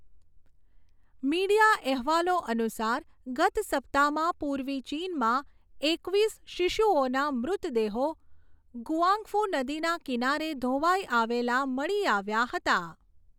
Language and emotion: Gujarati, neutral